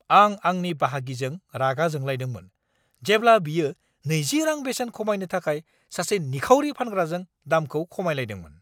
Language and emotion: Bodo, angry